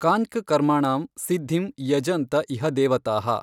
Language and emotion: Kannada, neutral